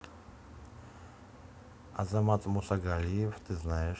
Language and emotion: Russian, neutral